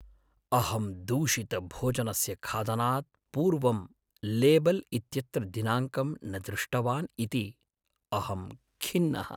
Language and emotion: Sanskrit, sad